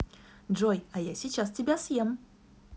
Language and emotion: Russian, positive